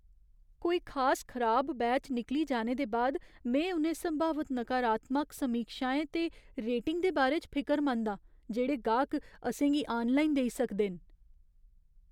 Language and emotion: Dogri, fearful